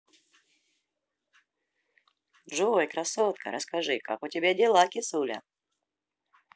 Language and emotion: Russian, positive